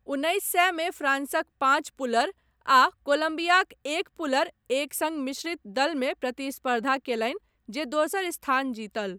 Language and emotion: Maithili, neutral